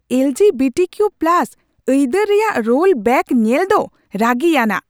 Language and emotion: Santali, angry